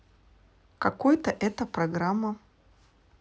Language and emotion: Russian, neutral